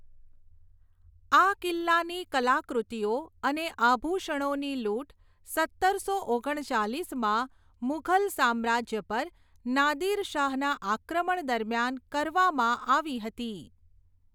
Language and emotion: Gujarati, neutral